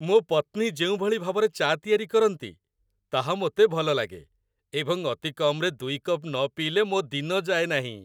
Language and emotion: Odia, happy